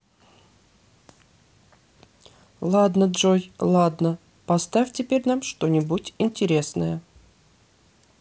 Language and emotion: Russian, neutral